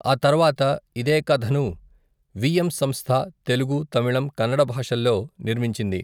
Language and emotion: Telugu, neutral